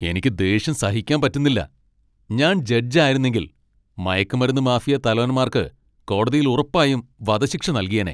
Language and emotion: Malayalam, angry